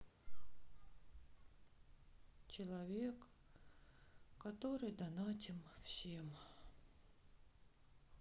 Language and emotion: Russian, sad